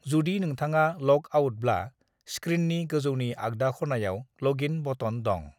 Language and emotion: Bodo, neutral